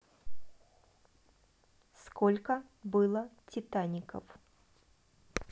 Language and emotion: Russian, neutral